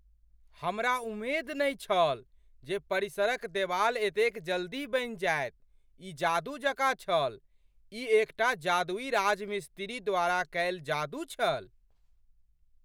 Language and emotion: Maithili, surprised